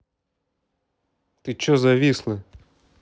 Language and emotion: Russian, angry